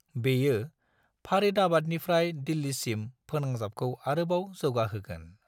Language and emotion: Bodo, neutral